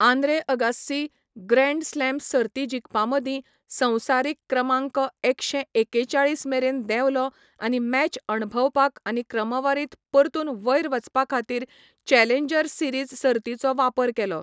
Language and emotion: Goan Konkani, neutral